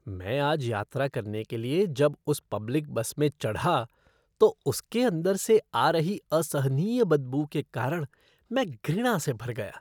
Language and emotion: Hindi, disgusted